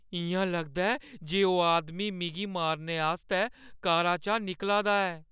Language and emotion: Dogri, fearful